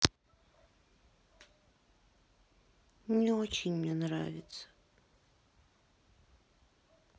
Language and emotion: Russian, sad